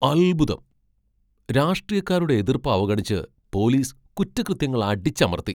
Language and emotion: Malayalam, surprised